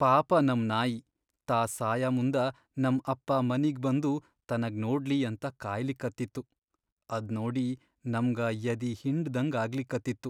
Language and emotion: Kannada, sad